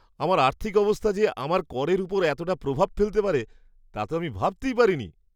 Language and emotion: Bengali, surprised